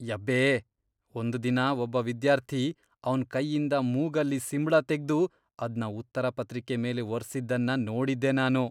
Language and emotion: Kannada, disgusted